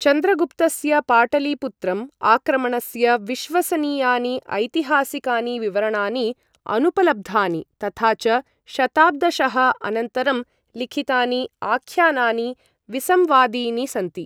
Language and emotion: Sanskrit, neutral